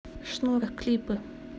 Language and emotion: Russian, neutral